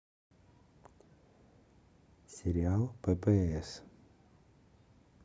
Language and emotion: Russian, neutral